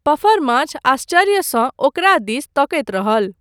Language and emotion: Maithili, neutral